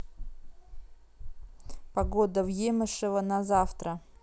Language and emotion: Russian, neutral